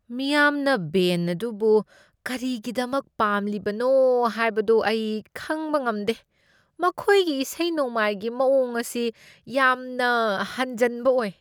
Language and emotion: Manipuri, disgusted